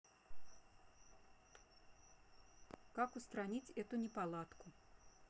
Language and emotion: Russian, neutral